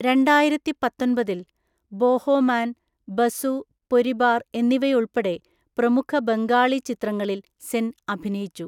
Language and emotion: Malayalam, neutral